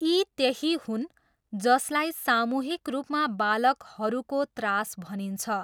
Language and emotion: Nepali, neutral